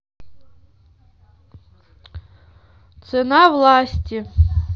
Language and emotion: Russian, neutral